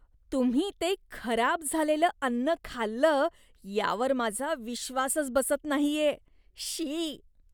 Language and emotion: Marathi, disgusted